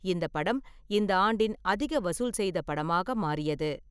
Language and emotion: Tamil, neutral